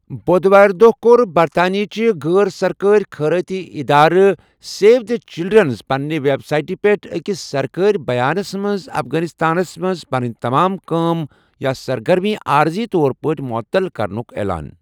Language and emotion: Kashmiri, neutral